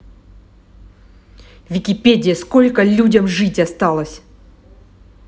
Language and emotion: Russian, angry